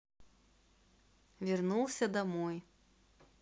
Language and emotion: Russian, neutral